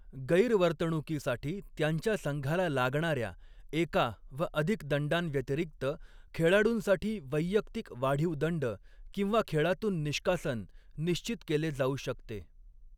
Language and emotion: Marathi, neutral